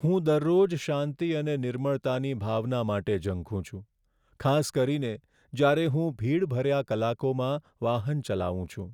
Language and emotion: Gujarati, sad